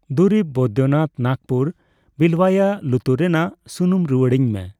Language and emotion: Santali, neutral